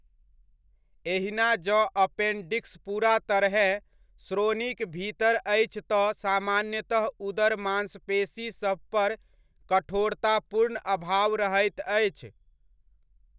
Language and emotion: Maithili, neutral